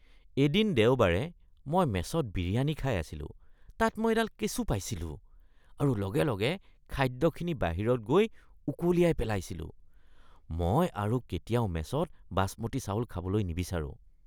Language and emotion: Assamese, disgusted